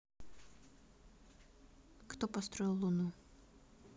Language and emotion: Russian, neutral